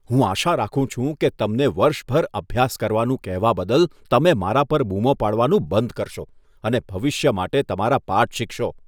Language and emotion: Gujarati, disgusted